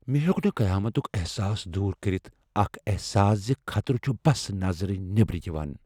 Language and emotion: Kashmiri, fearful